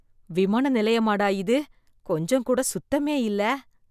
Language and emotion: Tamil, disgusted